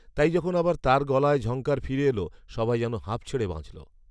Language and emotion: Bengali, neutral